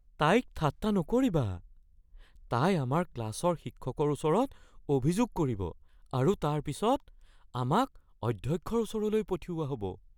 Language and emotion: Assamese, fearful